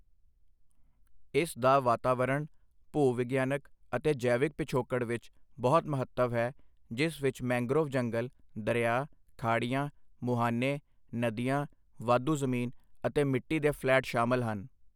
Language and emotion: Punjabi, neutral